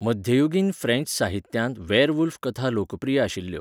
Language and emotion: Goan Konkani, neutral